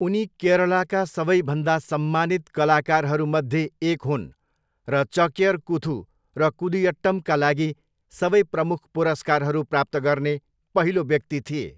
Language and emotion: Nepali, neutral